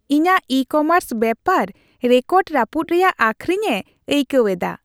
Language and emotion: Santali, happy